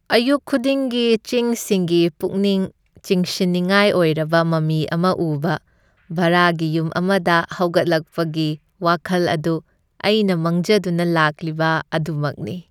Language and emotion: Manipuri, happy